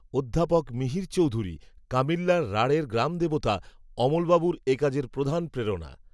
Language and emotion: Bengali, neutral